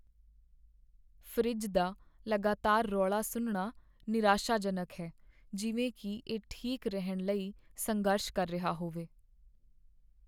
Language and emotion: Punjabi, sad